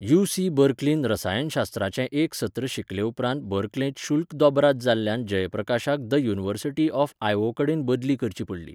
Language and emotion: Goan Konkani, neutral